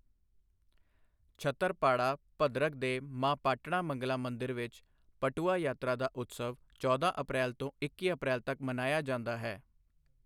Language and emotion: Punjabi, neutral